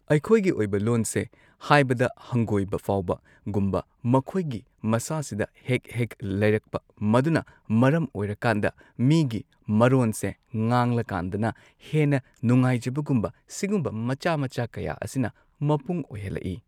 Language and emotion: Manipuri, neutral